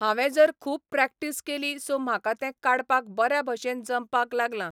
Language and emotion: Goan Konkani, neutral